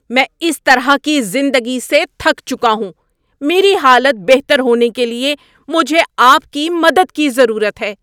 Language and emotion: Urdu, angry